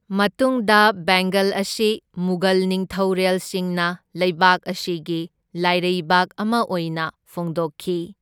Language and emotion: Manipuri, neutral